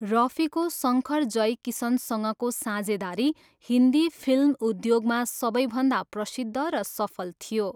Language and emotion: Nepali, neutral